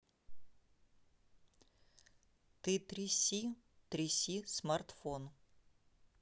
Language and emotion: Russian, neutral